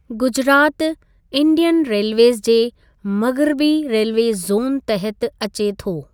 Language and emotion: Sindhi, neutral